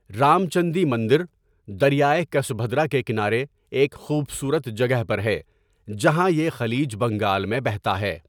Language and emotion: Urdu, neutral